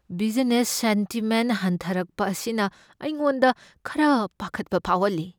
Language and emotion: Manipuri, fearful